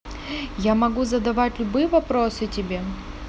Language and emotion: Russian, neutral